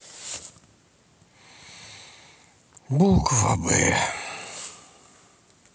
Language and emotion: Russian, sad